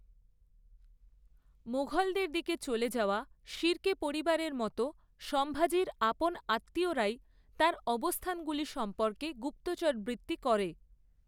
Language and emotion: Bengali, neutral